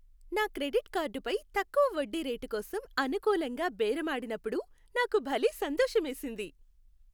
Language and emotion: Telugu, happy